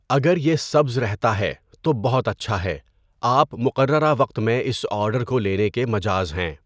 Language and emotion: Urdu, neutral